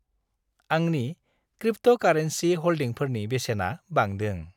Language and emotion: Bodo, happy